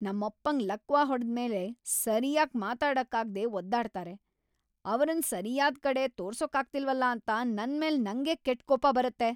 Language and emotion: Kannada, angry